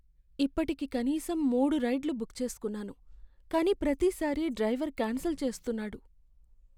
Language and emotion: Telugu, sad